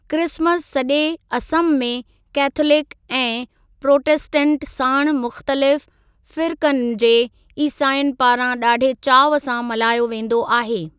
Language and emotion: Sindhi, neutral